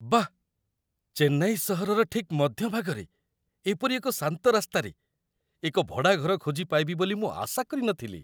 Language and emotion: Odia, surprised